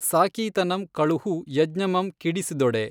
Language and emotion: Kannada, neutral